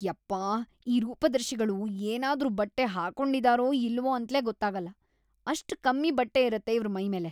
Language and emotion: Kannada, disgusted